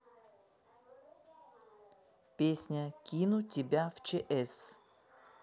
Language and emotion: Russian, neutral